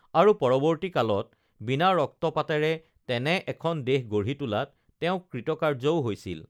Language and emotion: Assamese, neutral